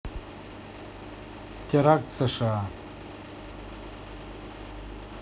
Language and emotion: Russian, neutral